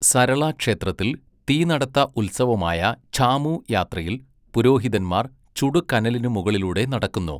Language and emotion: Malayalam, neutral